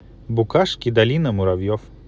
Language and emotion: Russian, positive